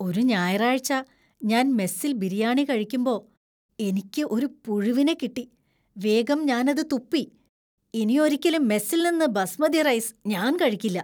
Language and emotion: Malayalam, disgusted